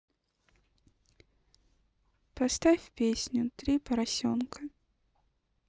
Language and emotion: Russian, sad